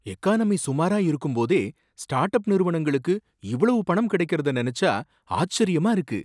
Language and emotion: Tamil, surprised